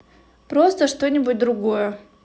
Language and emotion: Russian, neutral